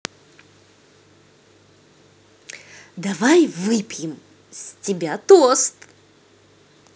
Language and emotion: Russian, positive